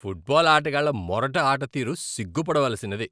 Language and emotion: Telugu, disgusted